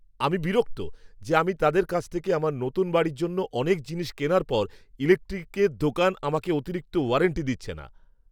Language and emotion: Bengali, angry